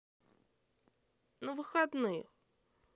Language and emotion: Russian, neutral